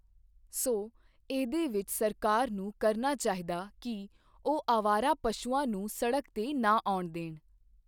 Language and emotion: Punjabi, neutral